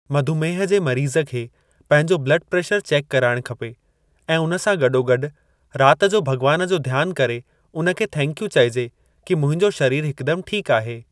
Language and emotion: Sindhi, neutral